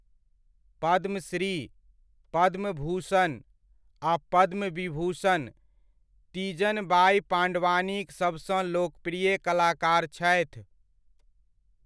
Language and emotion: Maithili, neutral